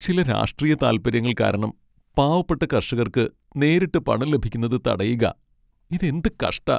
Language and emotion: Malayalam, sad